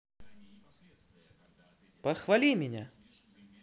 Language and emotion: Russian, positive